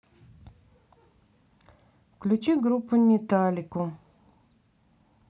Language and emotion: Russian, neutral